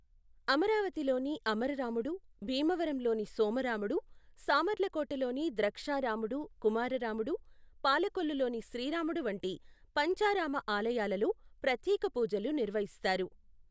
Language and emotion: Telugu, neutral